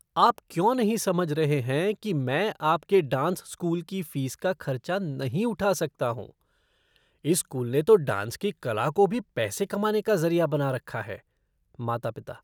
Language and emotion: Hindi, disgusted